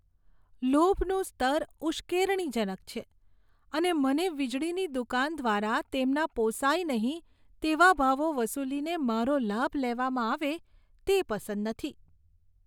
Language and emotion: Gujarati, disgusted